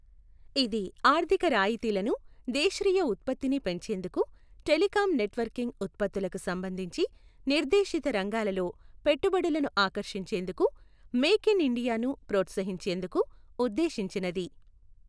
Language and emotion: Telugu, neutral